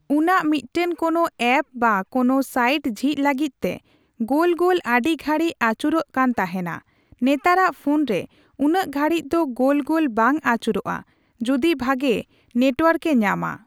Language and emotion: Santali, neutral